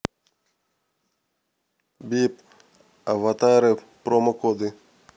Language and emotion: Russian, neutral